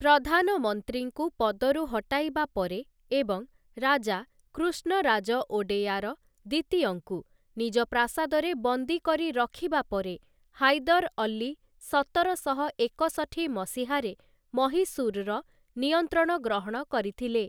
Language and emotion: Odia, neutral